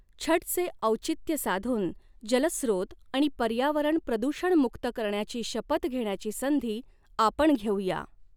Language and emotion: Marathi, neutral